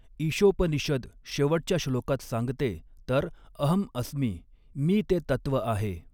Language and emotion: Marathi, neutral